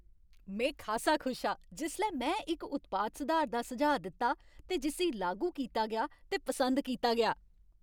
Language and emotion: Dogri, happy